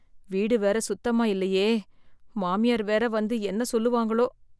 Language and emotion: Tamil, fearful